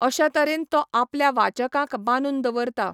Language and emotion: Goan Konkani, neutral